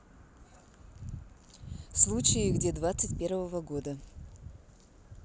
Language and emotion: Russian, neutral